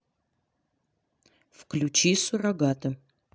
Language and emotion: Russian, neutral